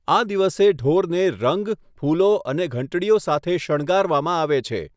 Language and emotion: Gujarati, neutral